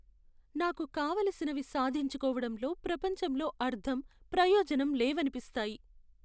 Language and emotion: Telugu, sad